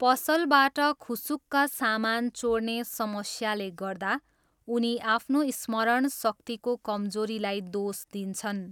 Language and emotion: Nepali, neutral